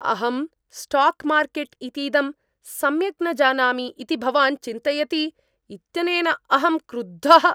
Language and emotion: Sanskrit, angry